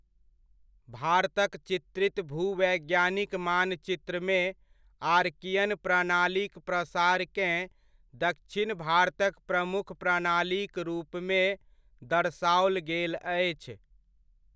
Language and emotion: Maithili, neutral